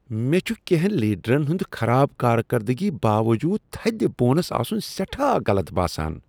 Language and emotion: Kashmiri, disgusted